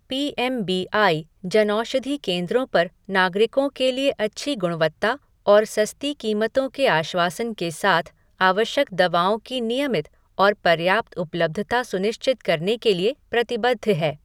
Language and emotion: Hindi, neutral